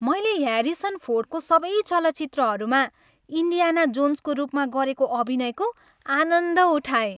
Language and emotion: Nepali, happy